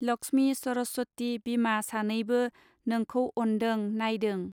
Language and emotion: Bodo, neutral